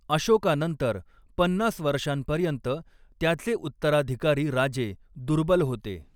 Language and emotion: Marathi, neutral